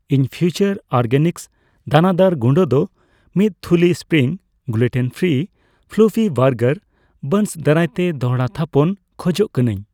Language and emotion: Santali, neutral